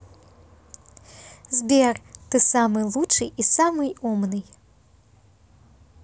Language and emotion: Russian, positive